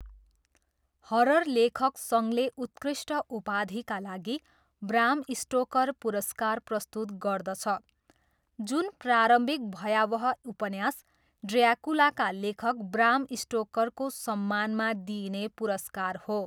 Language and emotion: Nepali, neutral